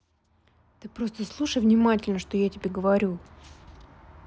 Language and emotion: Russian, neutral